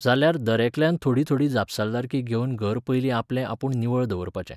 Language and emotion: Goan Konkani, neutral